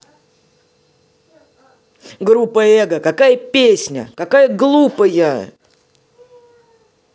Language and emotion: Russian, angry